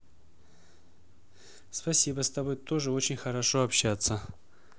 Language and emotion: Russian, neutral